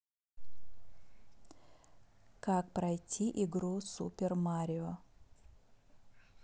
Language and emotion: Russian, neutral